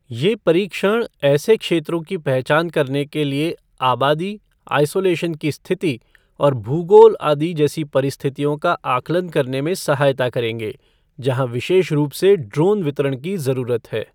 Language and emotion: Hindi, neutral